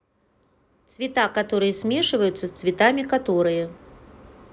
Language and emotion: Russian, neutral